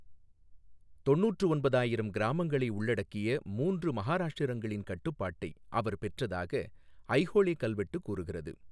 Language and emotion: Tamil, neutral